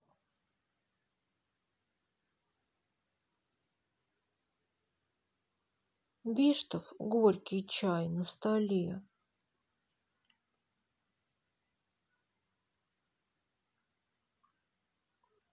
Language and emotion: Russian, sad